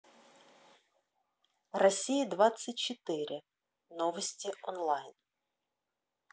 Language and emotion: Russian, neutral